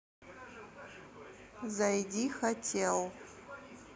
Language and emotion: Russian, neutral